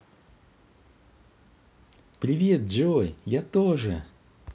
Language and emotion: Russian, positive